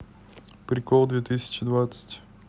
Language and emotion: Russian, neutral